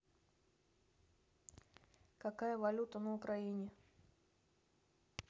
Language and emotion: Russian, neutral